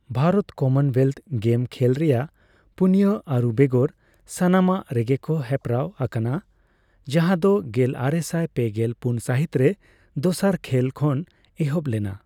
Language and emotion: Santali, neutral